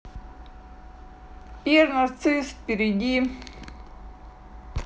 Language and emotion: Russian, neutral